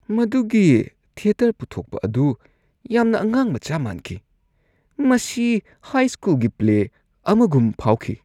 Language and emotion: Manipuri, disgusted